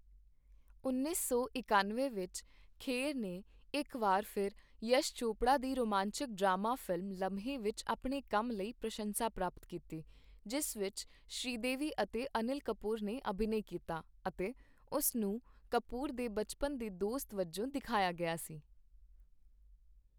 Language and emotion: Punjabi, neutral